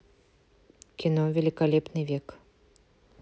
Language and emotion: Russian, neutral